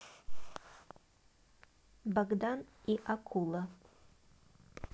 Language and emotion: Russian, neutral